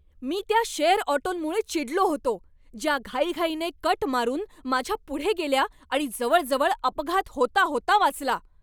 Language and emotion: Marathi, angry